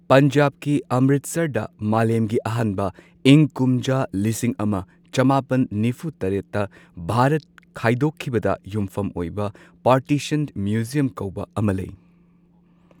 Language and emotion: Manipuri, neutral